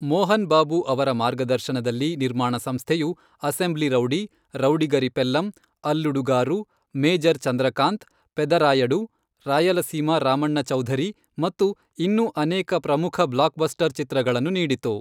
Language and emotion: Kannada, neutral